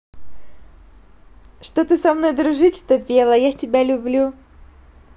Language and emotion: Russian, positive